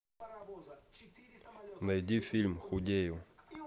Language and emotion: Russian, neutral